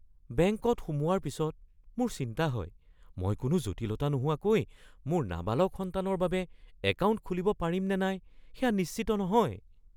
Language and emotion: Assamese, fearful